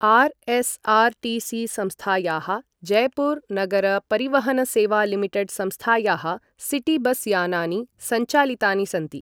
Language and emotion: Sanskrit, neutral